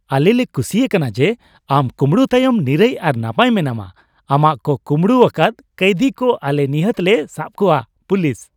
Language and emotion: Santali, happy